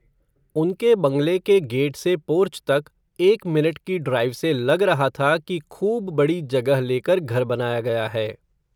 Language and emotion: Hindi, neutral